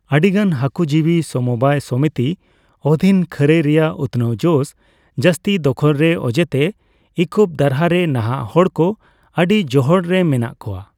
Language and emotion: Santali, neutral